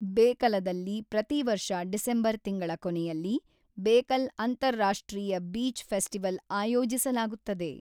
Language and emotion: Kannada, neutral